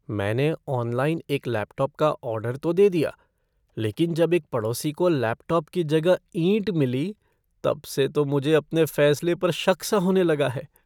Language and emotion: Hindi, fearful